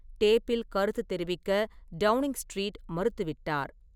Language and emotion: Tamil, neutral